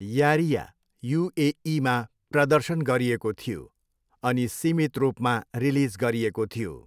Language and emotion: Nepali, neutral